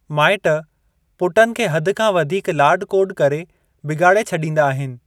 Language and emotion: Sindhi, neutral